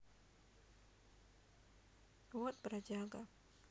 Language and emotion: Russian, sad